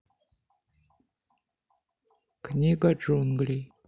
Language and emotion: Russian, neutral